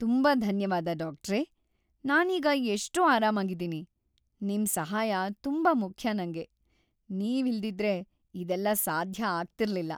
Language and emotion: Kannada, happy